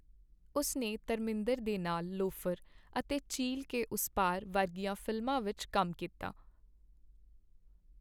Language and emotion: Punjabi, neutral